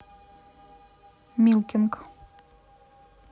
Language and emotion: Russian, neutral